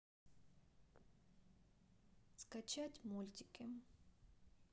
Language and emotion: Russian, sad